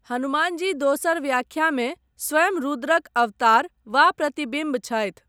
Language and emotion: Maithili, neutral